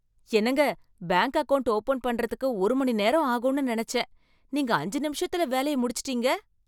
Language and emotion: Tamil, happy